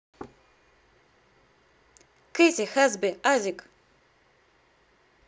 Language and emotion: Russian, positive